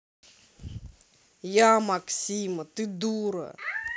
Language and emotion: Russian, angry